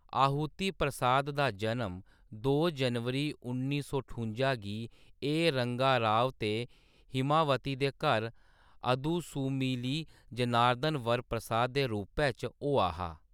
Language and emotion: Dogri, neutral